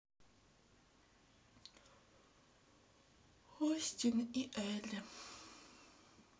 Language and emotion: Russian, sad